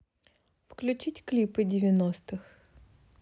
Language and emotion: Russian, neutral